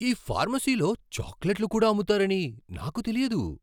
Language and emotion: Telugu, surprised